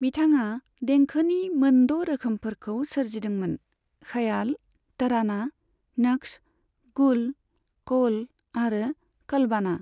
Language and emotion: Bodo, neutral